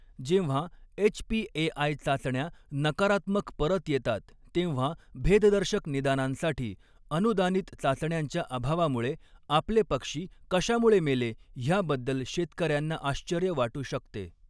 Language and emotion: Marathi, neutral